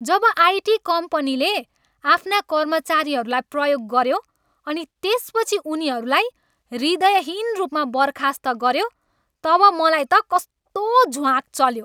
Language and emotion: Nepali, angry